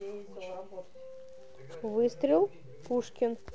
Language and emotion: Russian, neutral